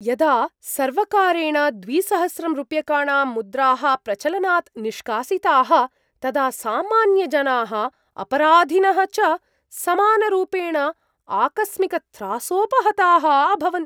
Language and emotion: Sanskrit, surprised